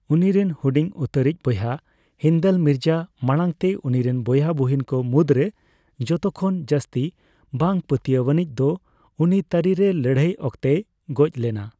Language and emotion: Santali, neutral